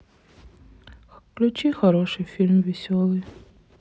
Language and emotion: Russian, sad